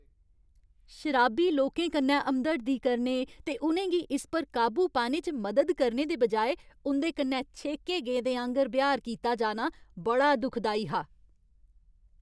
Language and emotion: Dogri, angry